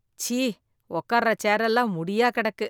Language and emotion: Tamil, disgusted